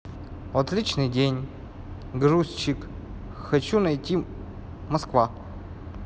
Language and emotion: Russian, neutral